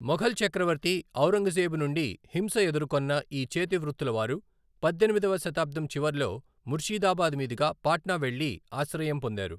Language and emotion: Telugu, neutral